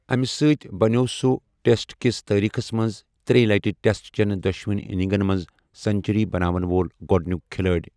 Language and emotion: Kashmiri, neutral